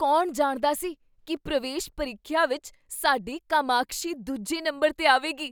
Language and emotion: Punjabi, surprised